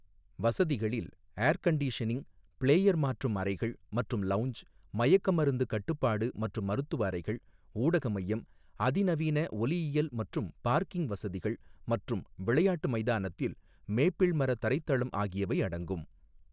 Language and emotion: Tamil, neutral